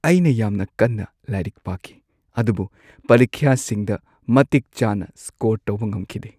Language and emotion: Manipuri, sad